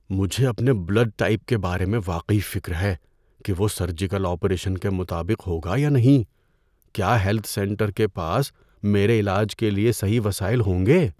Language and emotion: Urdu, fearful